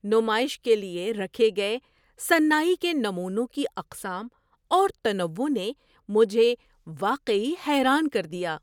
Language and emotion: Urdu, surprised